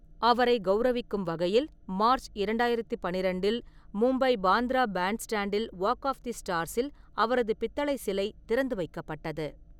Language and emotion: Tamil, neutral